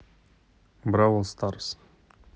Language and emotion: Russian, neutral